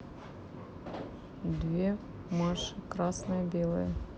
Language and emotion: Russian, neutral